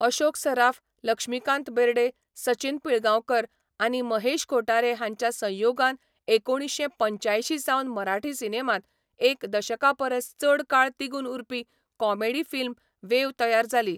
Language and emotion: Goan Konkani, neutral